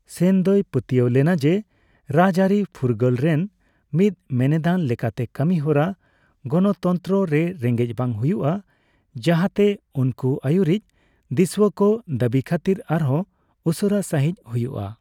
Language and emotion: Santali, neutral